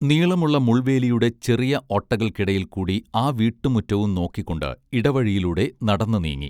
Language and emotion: Malayalam, neutral